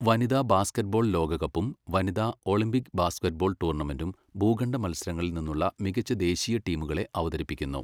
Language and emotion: Malayalam, neutral